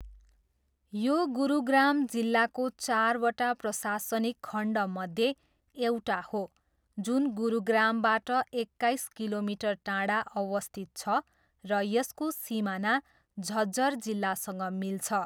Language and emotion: Nepali, neutral